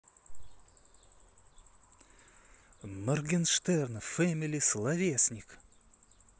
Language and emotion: Russian, positive